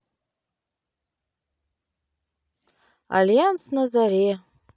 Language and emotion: Russian, neutral